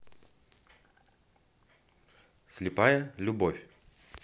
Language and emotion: Russian, neutral